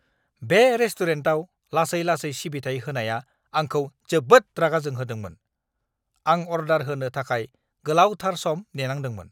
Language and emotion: Bodo, angry